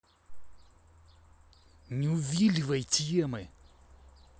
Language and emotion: Russian, angry